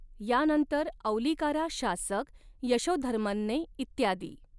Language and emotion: Marathi, neutral